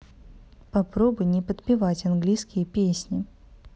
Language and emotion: Russian, neutral